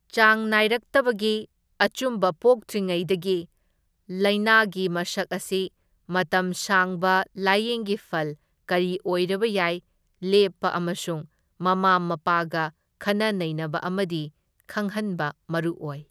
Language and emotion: Manipuri, neutral